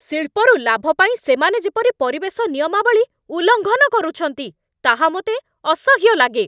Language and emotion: Odia, angry